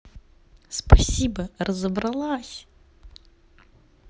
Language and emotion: Russian, positive